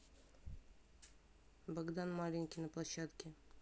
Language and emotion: Russian, neutral